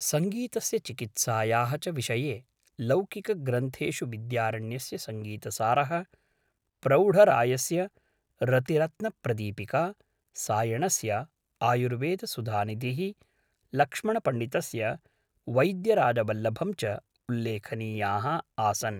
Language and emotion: Sanskrit, neutral